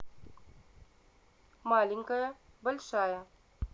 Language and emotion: Russian, neutral